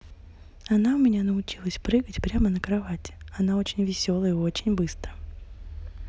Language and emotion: Russian, positive